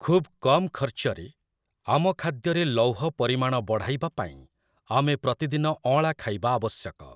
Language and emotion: Odia, neutral